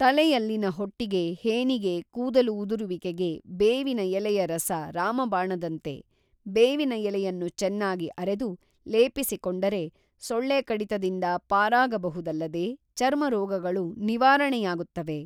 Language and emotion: Kannada, neutral